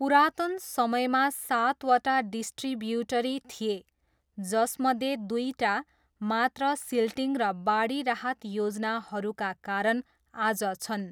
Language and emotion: Nepali, neutral